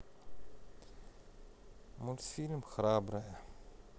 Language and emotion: Russian, neutral